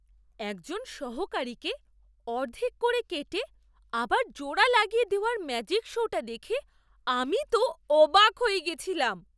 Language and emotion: Bengali, surprised